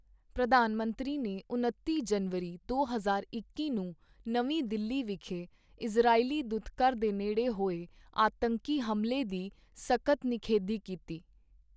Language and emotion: Punjabi, neutral